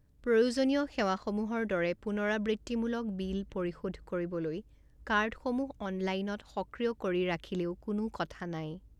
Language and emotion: Assamese, neutral